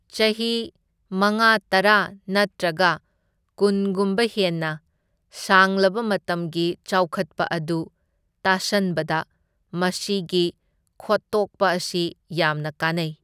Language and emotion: Manipuri, neutral